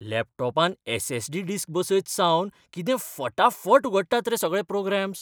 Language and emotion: Goan Konkani, surprised